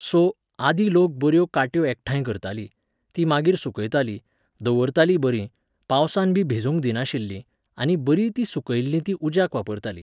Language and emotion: Goan Konkani, neutral